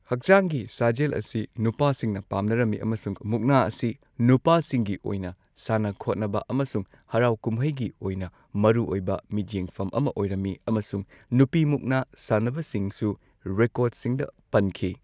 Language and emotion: Manipuri, neutral